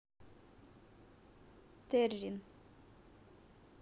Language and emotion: Russian, neutral